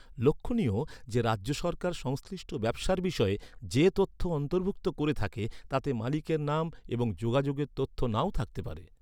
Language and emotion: Bengali, neutral